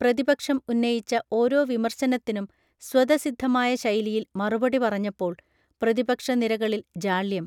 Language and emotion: Malayalam, neutral